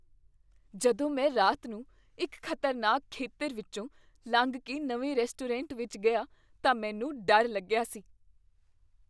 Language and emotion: Punjabi, fearful